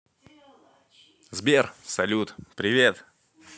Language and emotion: Russian, positive